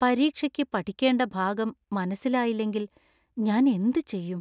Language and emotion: Malayalam, fearful